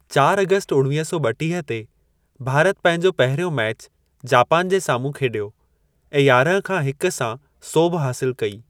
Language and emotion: Sindhi, neutral